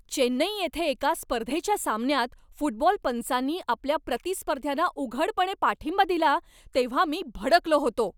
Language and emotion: Marathi, angry